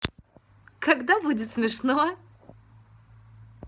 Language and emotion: Russian, positive